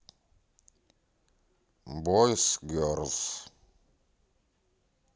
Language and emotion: Russian, neutral